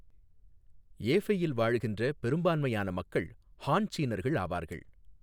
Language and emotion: Tamil, neutral